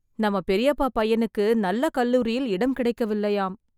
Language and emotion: Tamil, sad